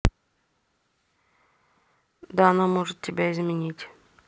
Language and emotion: Russian, neutral